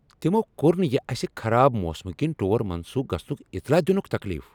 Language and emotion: Kashmiri, angry